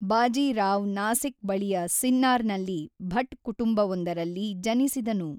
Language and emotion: Kannada, neutral